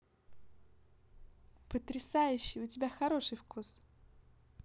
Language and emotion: Russian, positive